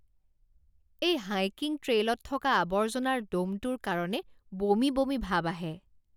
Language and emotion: Assamese, disgusted